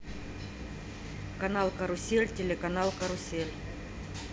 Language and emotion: Russian, neutral